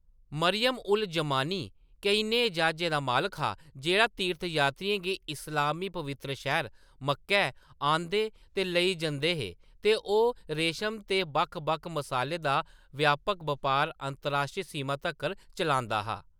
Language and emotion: Dogri, neutral